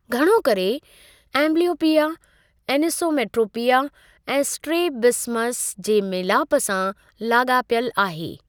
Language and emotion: Sindhi, neutral